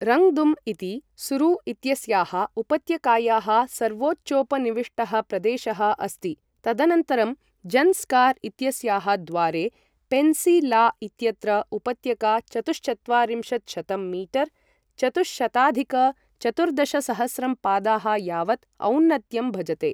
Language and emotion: Sanskrit, neutral